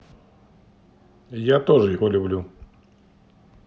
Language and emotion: Russian, neutral